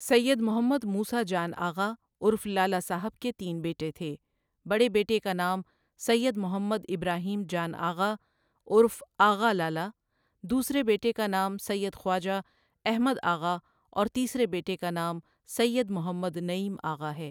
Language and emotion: Urdu, neutral